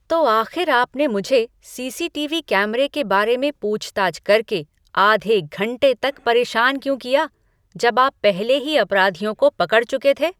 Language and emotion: Hindi, angry